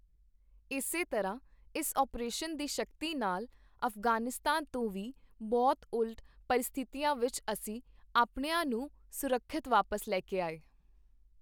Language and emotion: Punjabi, neutral